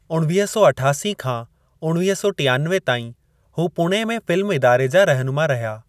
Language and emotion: Sindhi, neutral